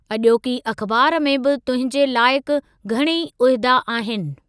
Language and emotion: Sindhi, neutral